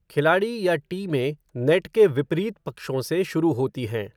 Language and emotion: Hindi, neutral